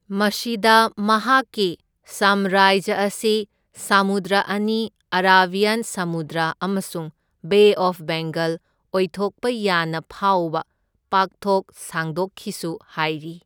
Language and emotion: Manipuri, neutral